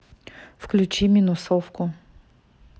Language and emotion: Russian, neutral